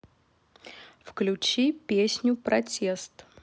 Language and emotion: Russian, neutral